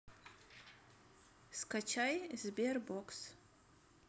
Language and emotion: Russian, neutral